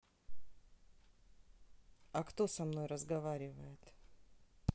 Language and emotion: Russian, neutral